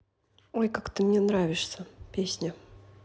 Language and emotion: Russian, neutral